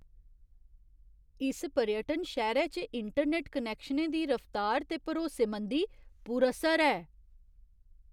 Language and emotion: Dogri, surprised